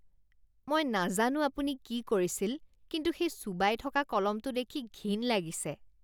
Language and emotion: Assamese, disgusted